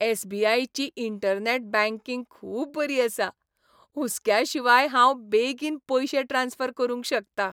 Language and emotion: Goan Konkani, happy